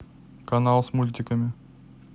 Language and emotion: Russian, neutral